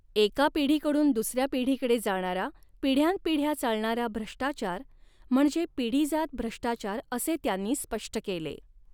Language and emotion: Marathi, neutral